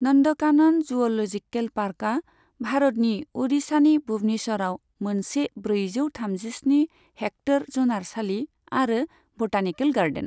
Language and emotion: Bodo, neutral